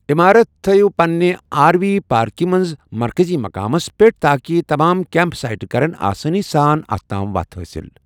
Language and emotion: Kashmiri, neutral